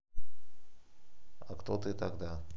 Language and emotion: Russian, neutral